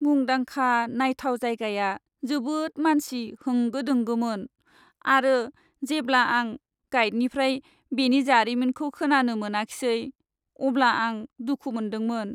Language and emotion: Bodo, sad